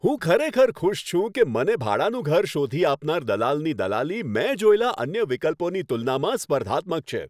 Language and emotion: Gujarati, happy